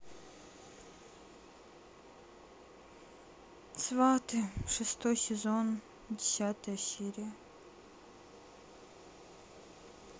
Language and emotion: Russian, sad